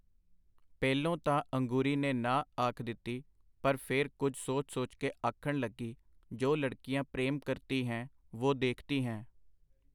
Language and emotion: Punjabi, neutral